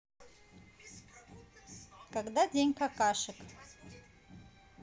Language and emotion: Russian, neutral